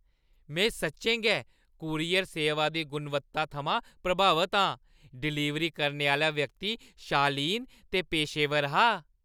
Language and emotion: Dogri, happy